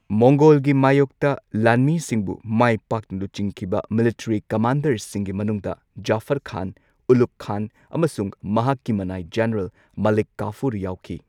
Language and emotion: Manipuri, neutral